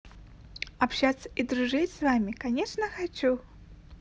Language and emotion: Russian, positive